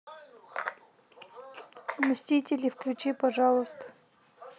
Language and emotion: Russian, neutral